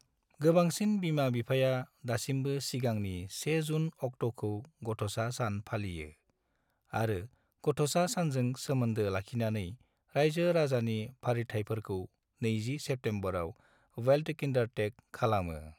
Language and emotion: Bodo, neutral